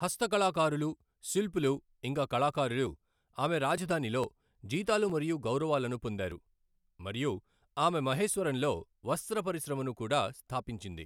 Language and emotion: Telugu, neutral